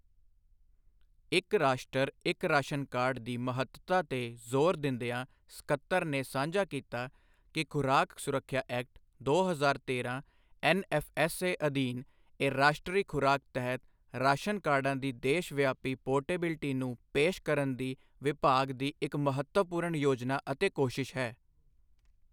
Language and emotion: Punjabi, neutral